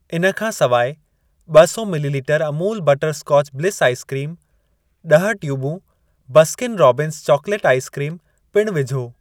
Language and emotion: Sindhi, neutral